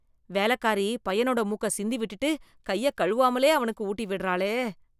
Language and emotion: Tamil, disgusted